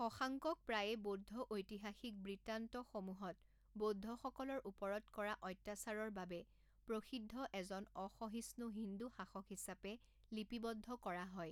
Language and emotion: Assamese, neutral